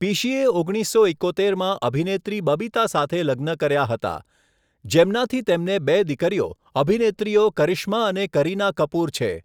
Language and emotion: Gujarati, neutral